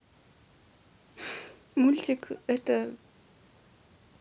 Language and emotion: Russian, sad